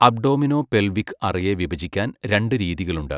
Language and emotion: Malayalam, neutral